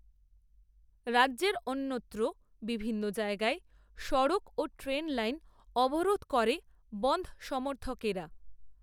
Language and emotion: Bengali, neutral